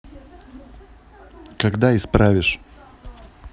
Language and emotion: Russian, neutral